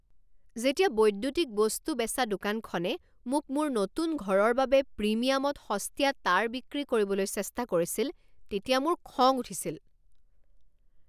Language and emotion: Assamese, angry